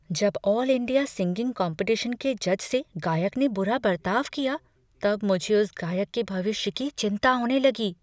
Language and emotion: Hindi, fearful